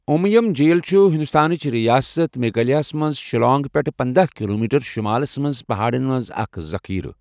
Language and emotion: Kashmiri, neutral